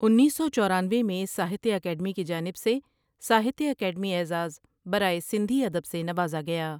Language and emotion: Urdu, neutral